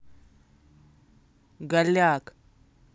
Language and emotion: Russian, angry